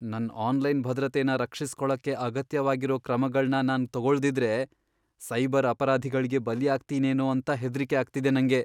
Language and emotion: Kannada, fearful